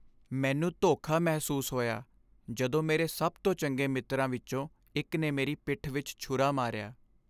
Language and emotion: Punjabi, sad